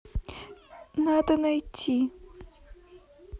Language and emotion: Russian, sad